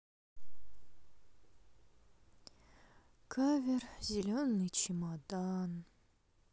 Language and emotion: Russian, sad